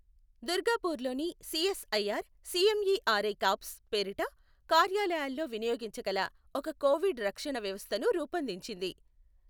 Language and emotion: Telugu, neutral